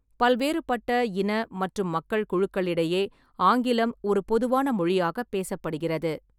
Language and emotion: Tamil, neutral